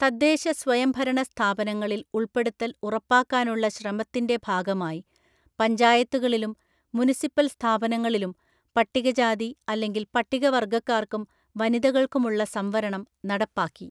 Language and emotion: Malayalam, neutral